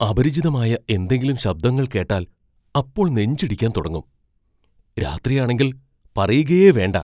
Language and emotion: Malayalam, fearful